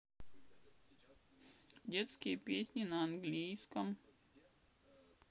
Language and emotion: Russian, sad